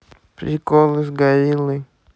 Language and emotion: Russian, neutral